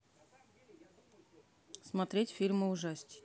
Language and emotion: Russian, neutral